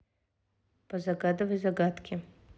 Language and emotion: Russian, neutral